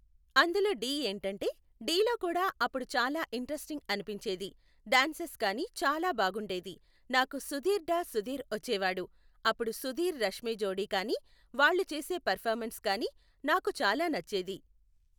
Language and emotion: Telugu, neutral